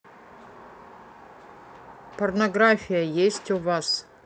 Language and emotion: Russian, neutral